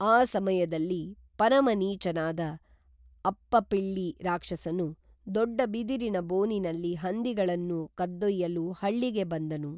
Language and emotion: Kannada, neutral